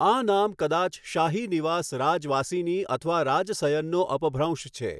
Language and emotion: Gujarati, neutral